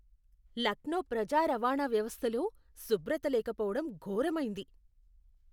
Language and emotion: Telugu, disgusted